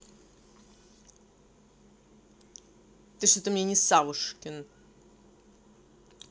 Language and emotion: Russian, angry